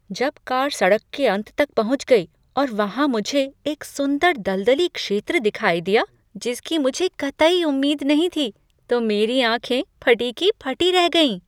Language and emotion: Hindi, surprised